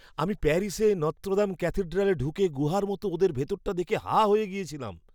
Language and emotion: Bengali, surprised